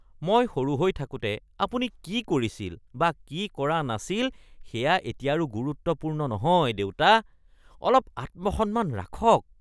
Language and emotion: Assamese, disgusted